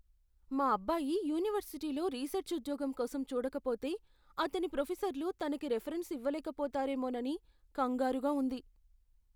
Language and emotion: Telugu, fearful